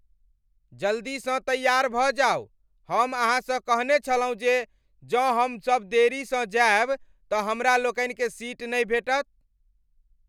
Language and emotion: Maithili, angry